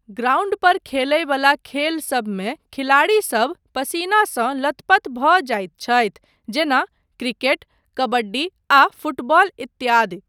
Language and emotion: Maithili, neutral